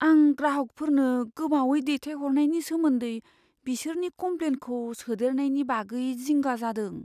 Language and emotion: Bodo, fearful